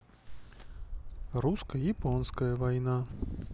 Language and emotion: Russian, neutral